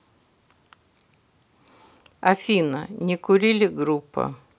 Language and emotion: Russian, neutral